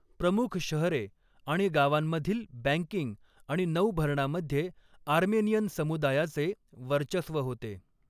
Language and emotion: Marathi, neutral